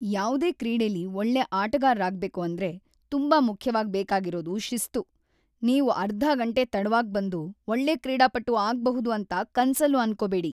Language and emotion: Kannada, angry